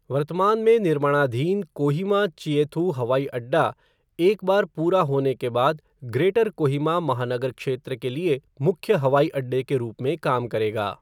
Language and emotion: Hindi, neutral